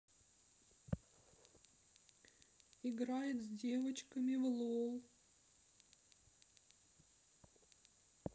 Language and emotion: Russian, sad